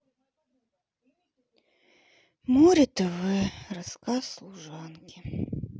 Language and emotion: Russian, sad